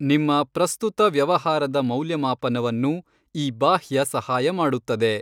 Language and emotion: Kannada, neutral